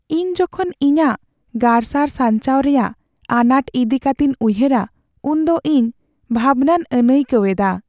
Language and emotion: Santali, sad